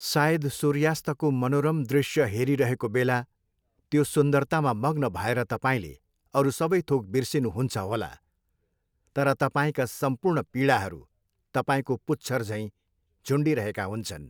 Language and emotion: Nepali, neutral